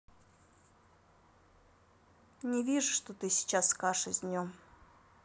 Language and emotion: Russian, neutral